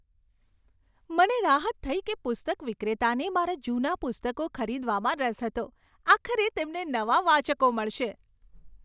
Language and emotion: Gujarati, happy